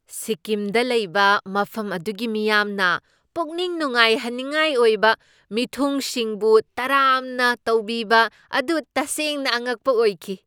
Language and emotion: Manipuri, surprised